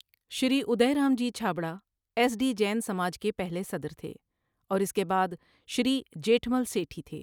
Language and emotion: Urdu, neutral